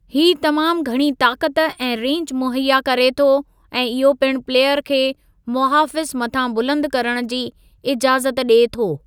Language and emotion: Sindhi, neutral